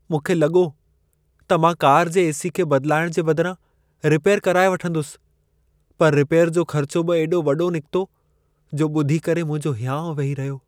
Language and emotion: Sindhi, sad